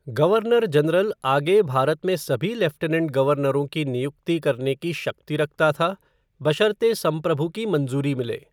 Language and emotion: Hindi, neutral